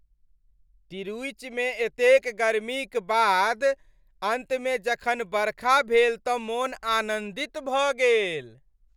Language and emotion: Maithili, happy